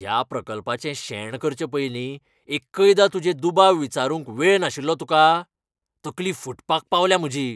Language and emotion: Goan Konkani, angry